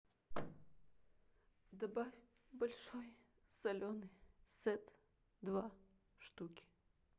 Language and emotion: Russian, sad